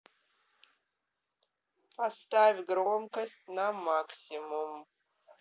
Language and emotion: Russian, neutral